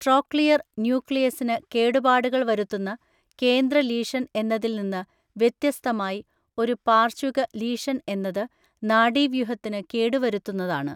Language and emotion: Malayalam, neutral